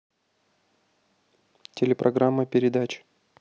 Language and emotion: Russian, neutral